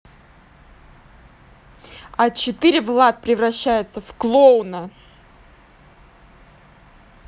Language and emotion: Russian, angry